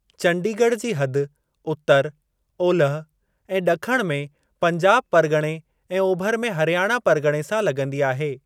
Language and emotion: Sindhi, neutral